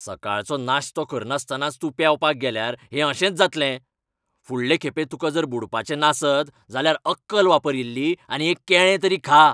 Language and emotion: Goan Konkani, angry